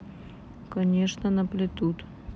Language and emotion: Russian, neutral